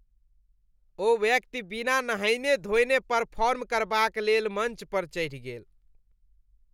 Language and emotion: Maithili, disgusted